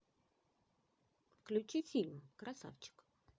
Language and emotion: Russian, positive